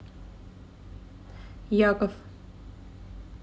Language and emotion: Russian, neutral